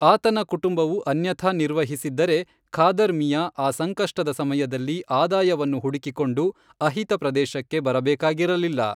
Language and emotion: Kannada, neutral